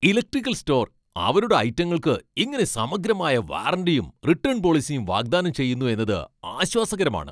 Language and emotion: Malayalam, happy